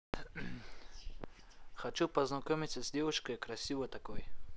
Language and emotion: Russian, neutral